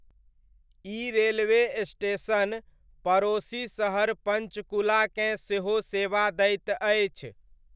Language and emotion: Maithili, neutral